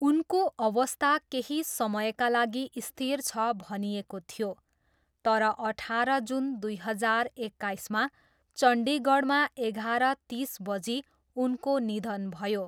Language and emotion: Nepali, neutral